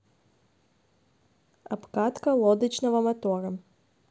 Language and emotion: Russian, neutral